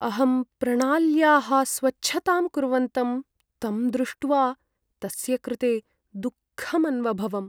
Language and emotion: Sanskrit, sad